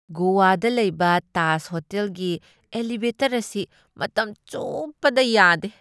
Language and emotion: Manipuri, disgusted